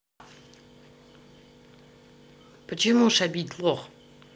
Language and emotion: Russian, neutral